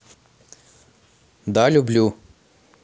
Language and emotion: Russian, neutral